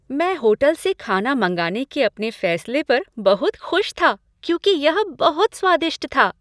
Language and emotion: Hindi, happy